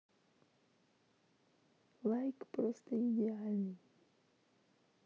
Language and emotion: Russian, neutral